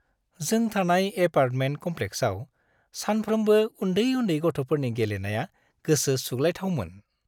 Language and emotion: Bodo, happy